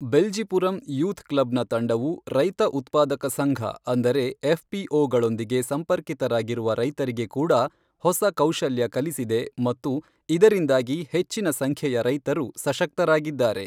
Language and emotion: Kannada, neutral